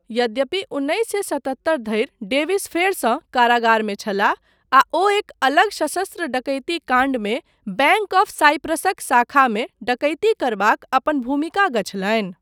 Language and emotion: Maithili, neutral